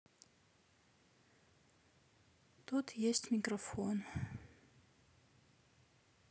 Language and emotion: Russian, sad